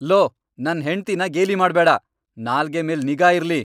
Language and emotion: Kannada, angry